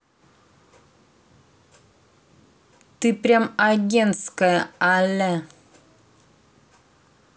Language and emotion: Russian, angry